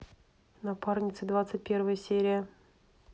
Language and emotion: Russian, neutral